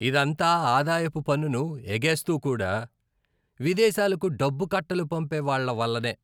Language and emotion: Telugu, disgusted